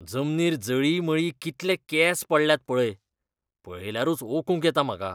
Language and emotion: Goan Konkani, disgusted